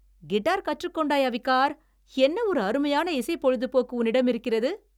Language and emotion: Tamil, happy